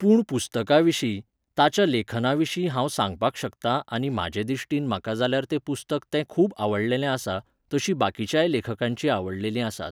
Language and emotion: Goan Konkani, neutral